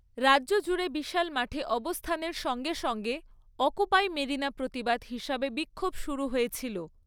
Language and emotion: Bengali, neutral